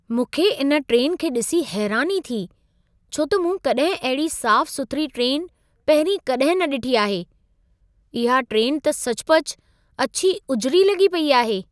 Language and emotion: Sindhi, surprised